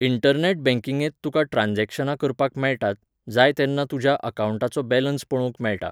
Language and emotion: Goan Konkani, neutral